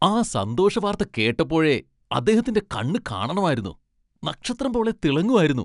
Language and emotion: Malayalam, happy